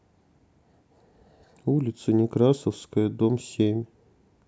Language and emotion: Russian, neutral